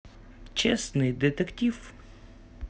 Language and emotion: Russian, positive